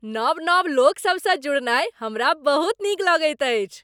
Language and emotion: Maithili, happy